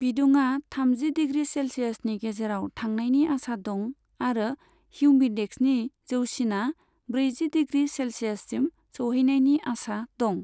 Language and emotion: Bodo, neutral